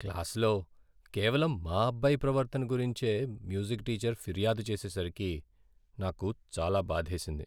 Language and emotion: Telugu, sad